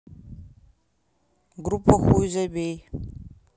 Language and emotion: Russian, neutral